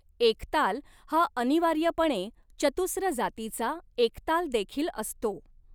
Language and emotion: Marathi, neutral